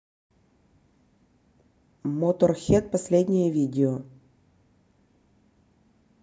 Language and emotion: Russian, neutral